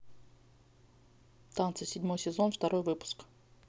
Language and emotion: Russian, neutral